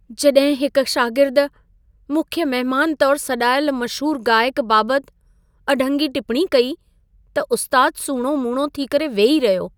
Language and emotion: Sindhi, sad